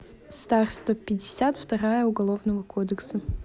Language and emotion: Russian, neutral